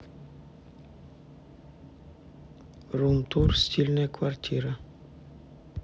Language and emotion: Russian, neutral